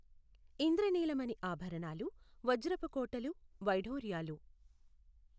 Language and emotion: Telugu, neutral